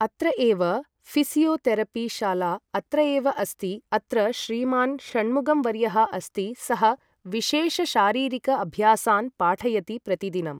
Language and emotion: Sanskrit, neutral